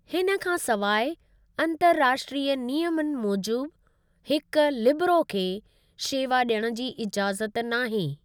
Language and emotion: Sindhi, neutral